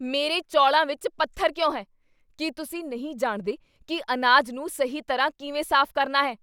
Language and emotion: Punjabi, angry